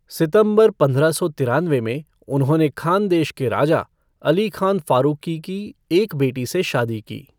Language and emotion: Hindi, neutral